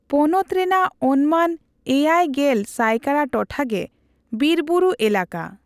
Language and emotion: Santali, neutral